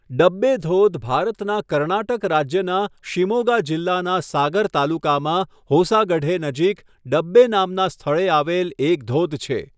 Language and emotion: Gujarati, neutral